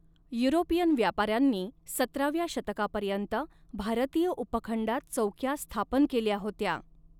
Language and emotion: Marathi, neutral